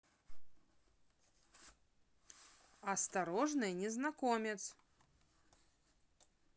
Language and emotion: Russian, neutral